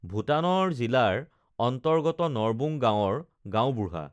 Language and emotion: Assamese, neutral